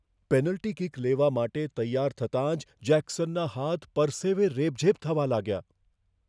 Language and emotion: Gujarati, fearful